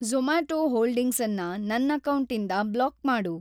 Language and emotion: Kannada, neutral